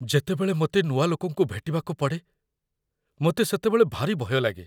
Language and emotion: Odia, fearful